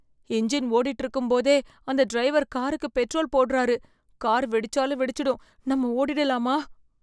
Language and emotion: Tamil, fearful